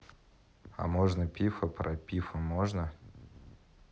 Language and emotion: Russian, neutral